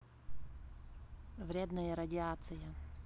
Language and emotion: Russian, neutral